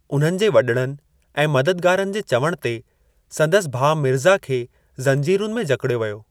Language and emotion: Sindhi, neutral